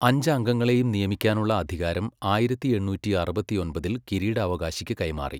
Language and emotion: Malayalam, neutral